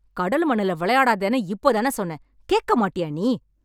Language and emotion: Tamil, angry